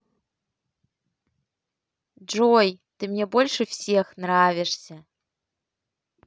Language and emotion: Russian, positive